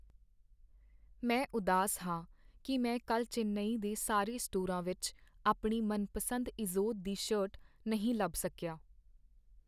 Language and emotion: Punjabi, sad